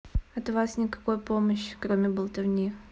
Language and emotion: Russian, neutral